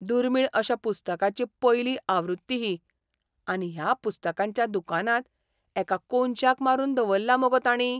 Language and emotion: Goan Konkani, surprised